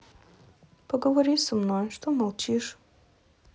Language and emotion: Russian, sad